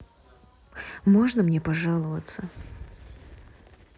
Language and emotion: Russian, neutral